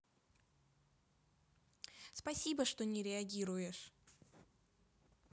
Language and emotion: Russian, positive